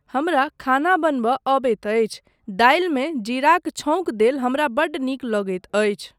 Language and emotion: Maithili, neutral